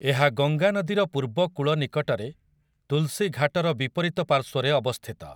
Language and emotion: Odia, neutral